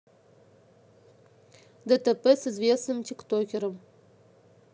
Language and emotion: Russian, neutral